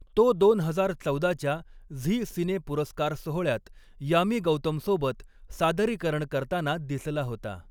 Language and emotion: Marathi, neutral